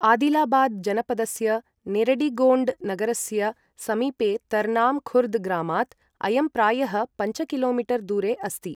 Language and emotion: Sanskrit, neutral